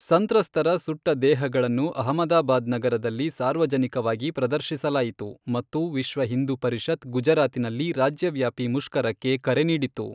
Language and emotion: Kannada, neutral